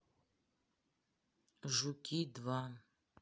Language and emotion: Russian, neutral